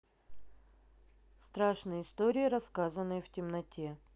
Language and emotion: Russian, neutral